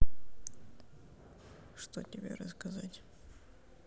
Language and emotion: Russian, neutral